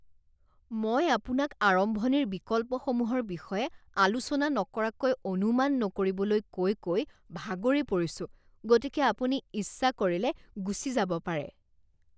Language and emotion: Assamese, disgusted